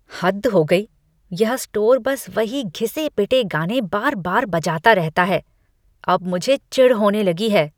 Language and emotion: Hindi, disgusted